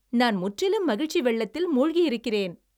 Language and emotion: Tamil, happy